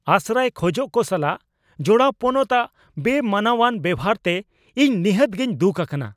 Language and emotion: Santali, angry